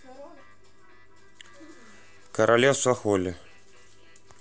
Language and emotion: Russian, neutral